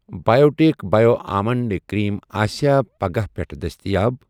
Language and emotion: Kashmiri, neutral